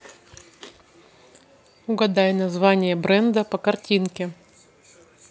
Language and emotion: Russian, neutral